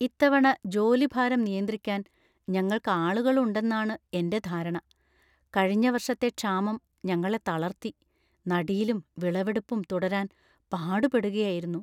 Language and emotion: Malayalam, fearful